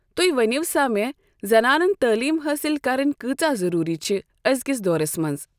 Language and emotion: Kashmiri, neutral